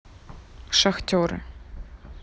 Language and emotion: Russian, neutral